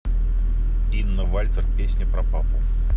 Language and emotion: Russian, neutral